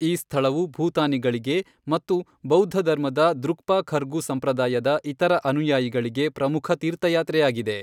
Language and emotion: Kannada, neutral